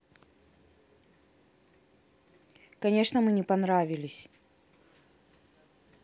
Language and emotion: Russian, angry